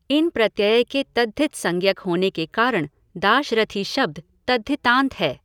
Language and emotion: Hindi, neutral